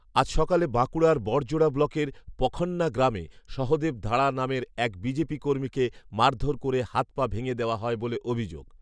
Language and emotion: Bengali, neutral